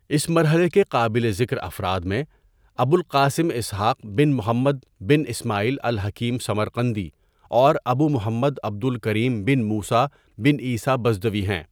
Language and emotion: Urdu, neutral